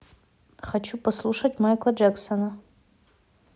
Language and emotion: Russian, neutral